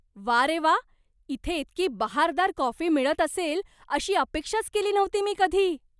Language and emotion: Marathi, surprised